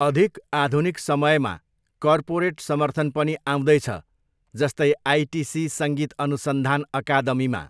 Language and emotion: Nepali, neutral